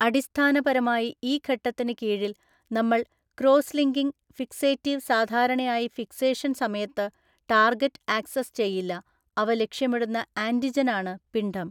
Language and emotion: Malayalam, neutral